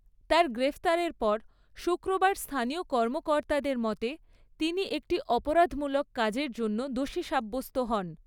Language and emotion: Bengali, neutral